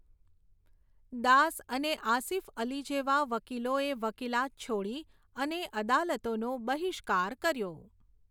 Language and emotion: Gujarati, neutral